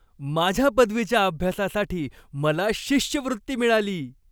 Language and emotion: Marathi, happy